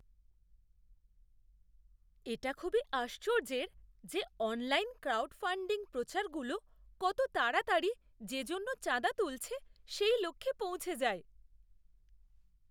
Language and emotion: Bengali, surprised